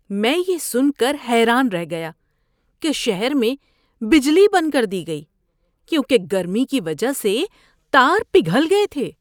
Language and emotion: Urdu, surprised